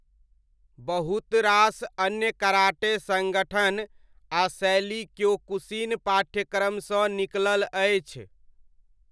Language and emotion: Maithili, neutral